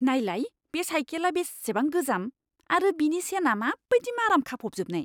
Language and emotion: Bodo, disgusted